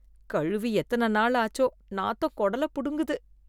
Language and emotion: Tamil, disgusted